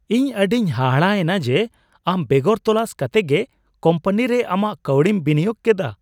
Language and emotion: Santali, surprised